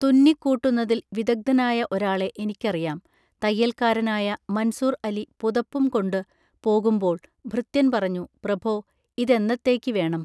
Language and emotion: Malayalam, neutral